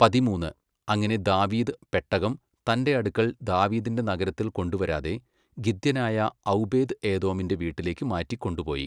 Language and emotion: Malayalam, neutral